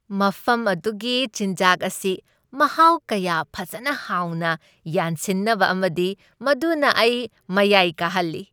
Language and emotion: Manipuri, happy